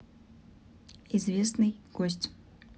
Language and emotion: Russian, neutral